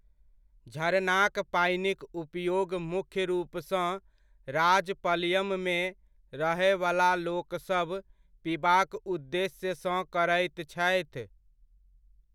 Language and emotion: Maithili, neutral